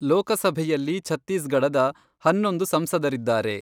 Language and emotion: Kannada, neutral